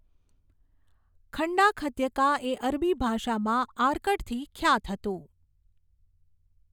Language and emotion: Gujarati, neutral